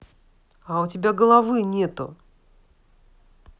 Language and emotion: Russian, angry